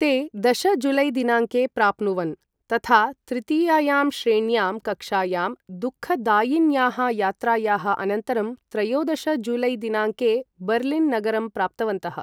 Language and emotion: Sanskrit, neutral